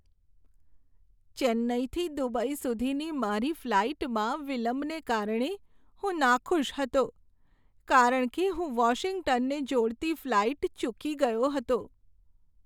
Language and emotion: Gujarati, sad